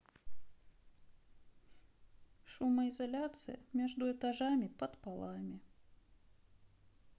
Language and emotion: Russian, sad